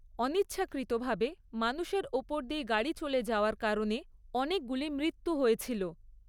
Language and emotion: Bengali, neutral